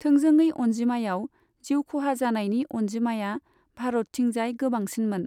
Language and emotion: Bodo, neutral